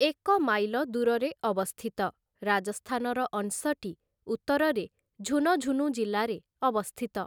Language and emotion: Odia, neutral